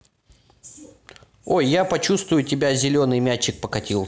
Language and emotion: Russian, positive